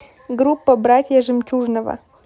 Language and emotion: Russian, neutral